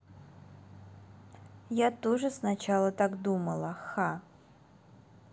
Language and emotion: Russian, neutral